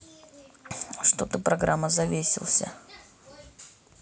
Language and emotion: Russian, neutral